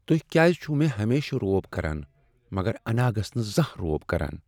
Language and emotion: Kashmiri, sad